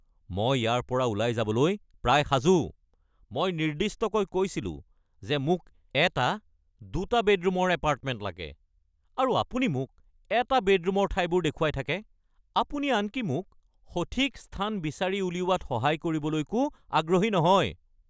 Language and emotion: Assamese, angry